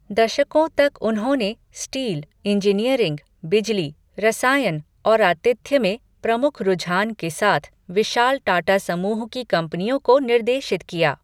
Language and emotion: Hindi, neutral